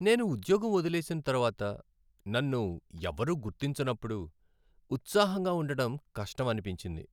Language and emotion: Telugu, sad